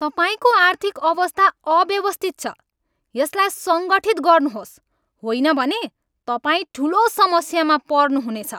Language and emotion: Nepali, angry